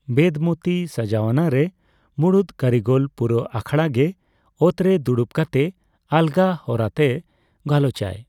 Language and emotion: Santali, neutral